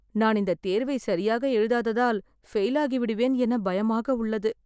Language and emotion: Tamil, fearful